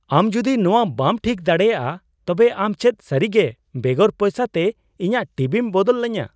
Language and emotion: Santali, surprised